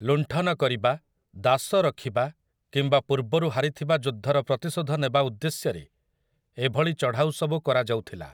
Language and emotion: Odia, neutral